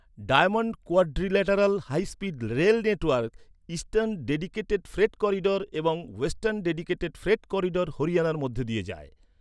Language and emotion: Bengali, neutral